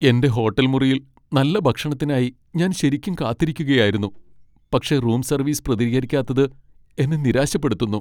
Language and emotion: Malayalam, sad